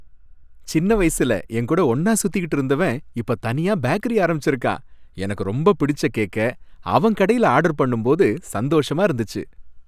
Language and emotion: Tamil, happy